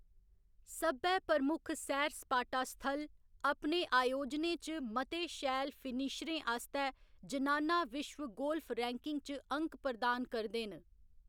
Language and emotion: Dogri, neutral